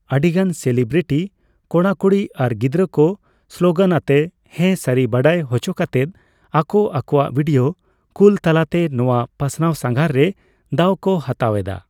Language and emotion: Santali, neutral